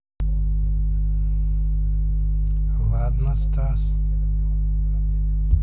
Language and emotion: Russian, neutral